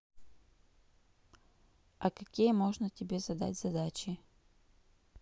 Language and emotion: Russian, neutral